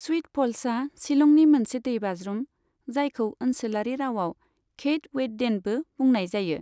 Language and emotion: Bodo, neutral